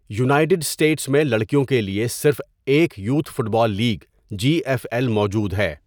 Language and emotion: Urdu, neutral